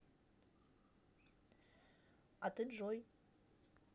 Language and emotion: Russian, neutral